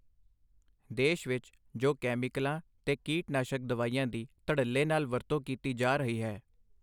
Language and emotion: Punjabi, neutral